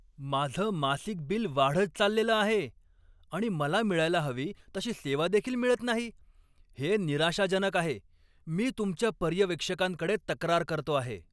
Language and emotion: Marathi, angry